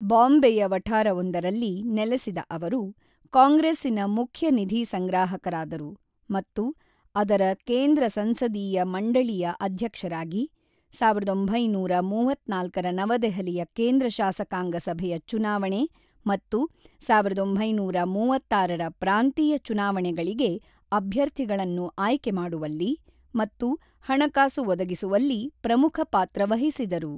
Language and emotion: Kannada, neutral